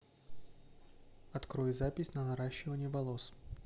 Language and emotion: Russian, neutral